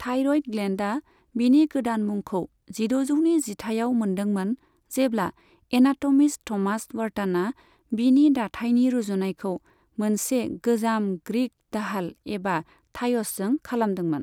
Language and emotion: Bodo, neutral